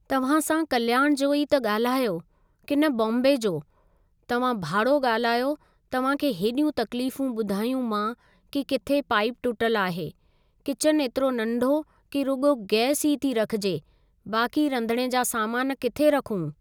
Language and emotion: Sindhi, neutral